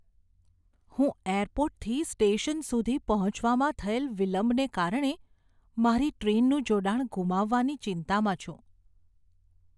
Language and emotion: Gujarati, fearful